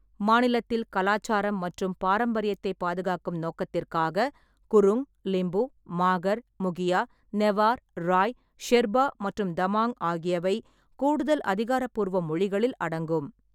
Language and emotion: Tamil, neutral